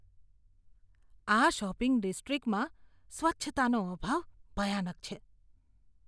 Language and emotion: Gujarati, disgusted